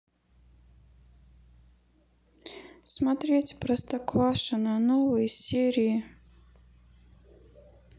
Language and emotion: Russian, sad